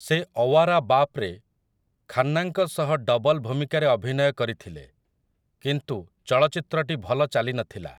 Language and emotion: Odia, neutral